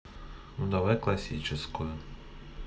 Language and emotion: Russian, neutral